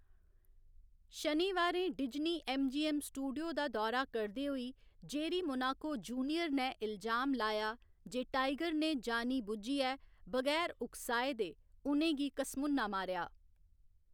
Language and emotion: Dogri, neutral